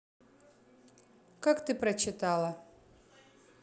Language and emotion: Russian, neutral